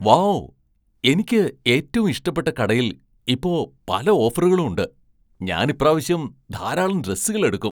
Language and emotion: Malayalam, surprised